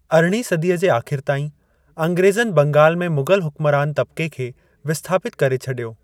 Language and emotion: Sindhi, neutral